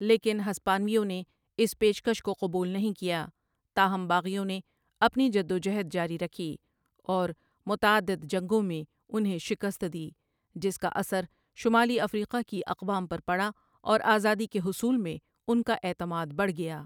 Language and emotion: Urdu, neutral